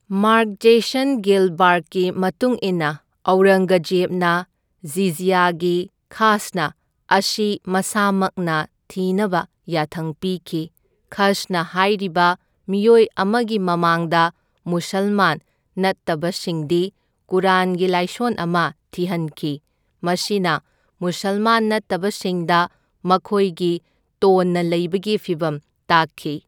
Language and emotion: Manipuri, neutral